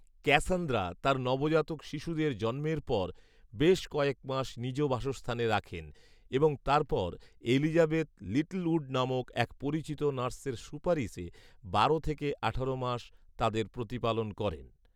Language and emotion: Bengali, neutral